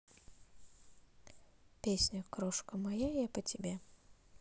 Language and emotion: Russian, neutral